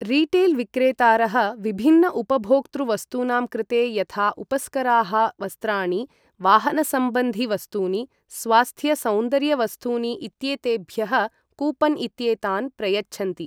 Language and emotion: Sanskrit, neutral